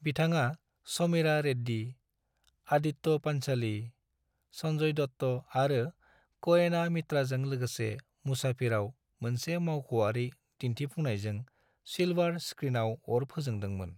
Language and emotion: Bodo, neutral